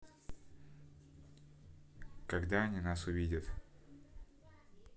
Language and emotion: Russian, neutral